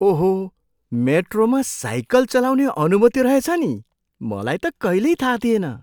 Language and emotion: Nepali, surprised